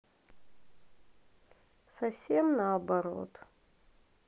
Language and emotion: Russian, sad